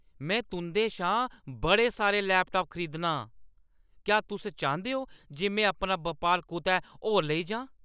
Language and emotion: Dogri, angry